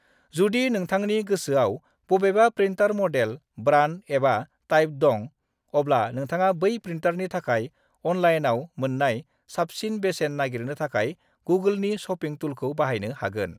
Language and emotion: Bodo, neutral